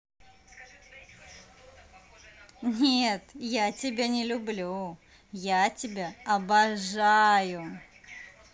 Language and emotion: Russian, positive